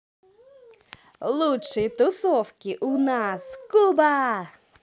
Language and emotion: Russian, positive